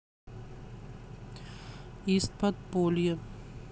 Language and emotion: Russian, neutral